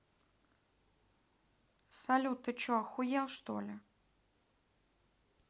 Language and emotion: Russian, neutral